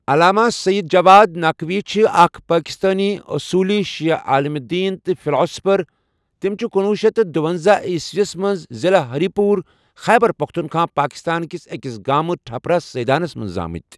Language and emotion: Kashmiri, neutral